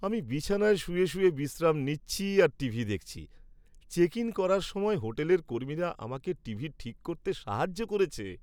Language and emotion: Bengali, happy